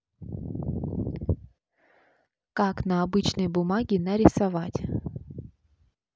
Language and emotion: Russian, neutral